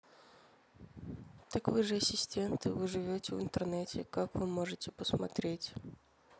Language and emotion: Russian, neutral